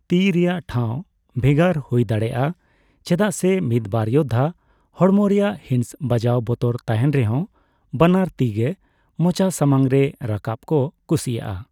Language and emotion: Santali, neutral